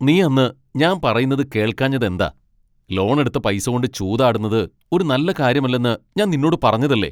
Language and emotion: Malayalam, angry